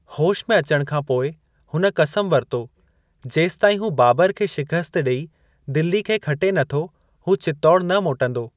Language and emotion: Sindhi, neutral